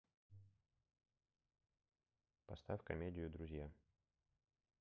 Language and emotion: Russian, neutral